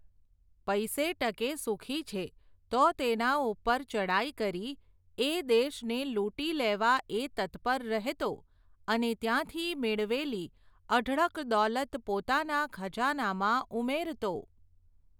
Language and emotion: Gujarati, neutral